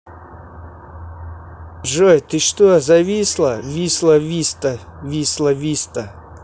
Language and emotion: Russian, neutral